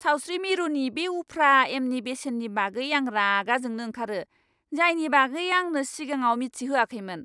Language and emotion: Bodo, angry